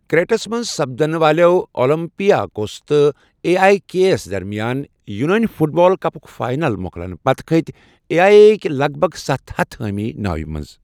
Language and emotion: Kashmiri, neutral